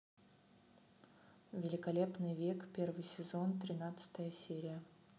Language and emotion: Russian, neutral